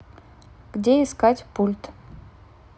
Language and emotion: Russian, neutral